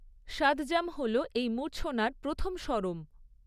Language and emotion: Bengali, neutral